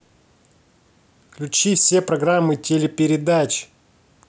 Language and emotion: Russian, angry